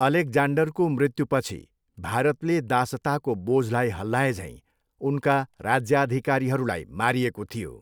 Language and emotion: Nepali, neutral